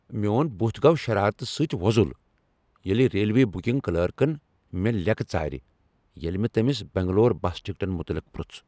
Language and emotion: Kashmiri, angry